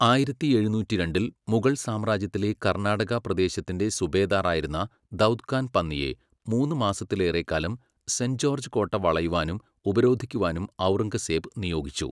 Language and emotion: Malayalam, neutral